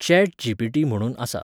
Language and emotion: Goan Konkani, neutral